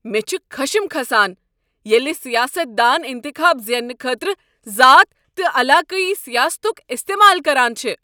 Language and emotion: Kashmiri, angry